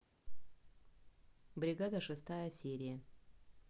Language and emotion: Russian, neutral